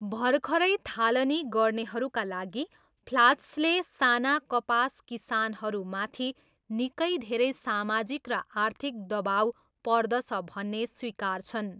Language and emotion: Nepali, neutral